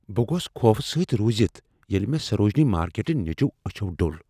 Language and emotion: Kashmiri, fearful